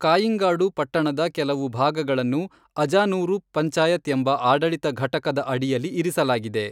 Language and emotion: Kannada, neutral